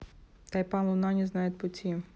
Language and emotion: Russian, neutral